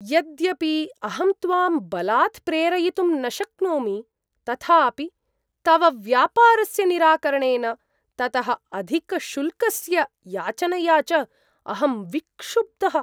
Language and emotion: Sanskrit, surprised